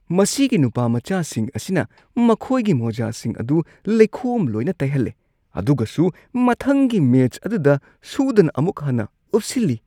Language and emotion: Manipuri, disgusted